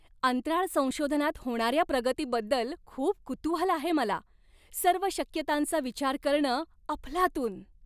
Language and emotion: Marathi, happy